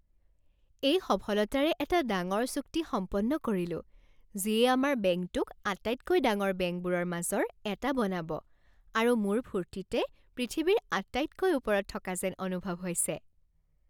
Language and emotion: Assamese, happy